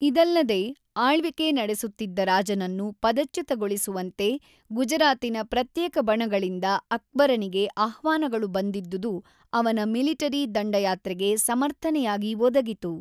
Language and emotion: Kannada, neutral